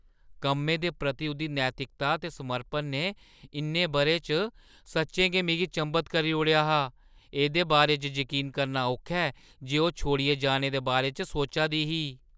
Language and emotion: Dogri, surprised